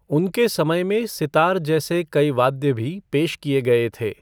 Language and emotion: Hindi, neutral